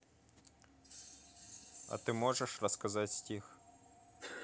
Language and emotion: Russian, neutral